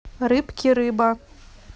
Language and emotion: Russian, neutral